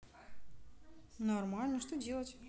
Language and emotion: Russian, neutral